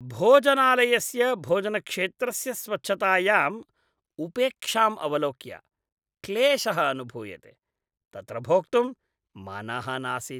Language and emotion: Sanskrit, disgusted